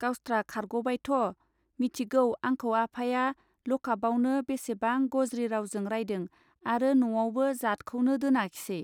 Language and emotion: Bodo, neutral